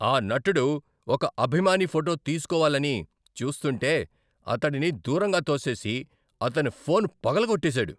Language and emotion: Telugu, angry